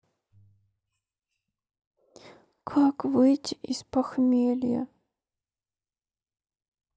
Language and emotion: Russian, sad